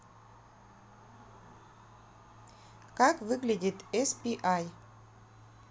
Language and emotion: Russian, neutral